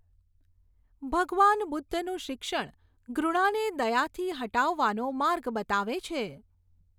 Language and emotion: Gujarati, neutral